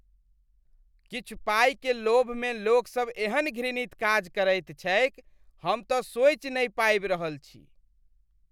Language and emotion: Maithili, disgusted